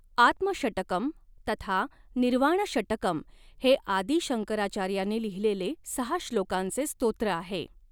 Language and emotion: Marathi, neutral